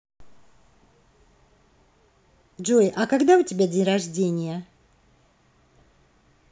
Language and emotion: Russian, positive